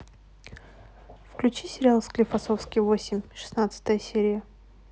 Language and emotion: Russian, neutral